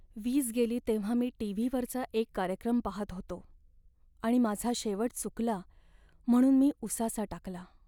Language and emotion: Marathi, sad